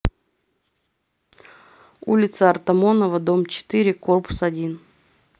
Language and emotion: Russian, neutral